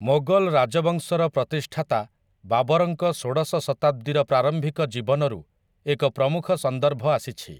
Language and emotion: Odia, neutral